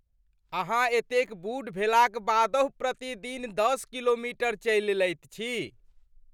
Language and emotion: Maithili, surprised